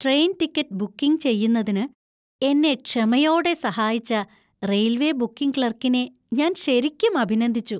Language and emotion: Malayalam, happy